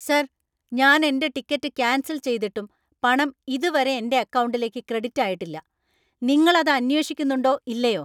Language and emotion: Malayalam, angry